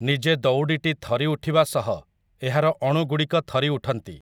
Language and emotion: Odia, neutral